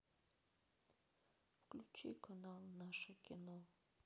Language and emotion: Russian, sad